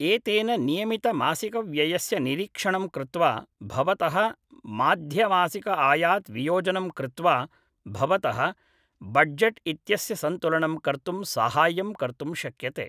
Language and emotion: Sanskrit, neutral